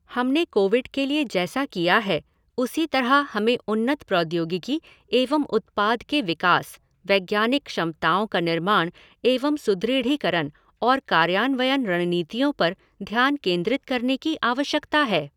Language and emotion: Hindi, neutral